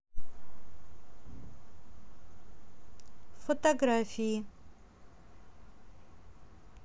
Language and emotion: Russian, neutral